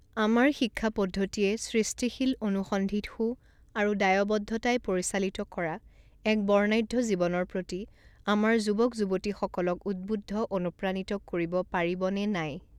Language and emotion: Assamese, neutral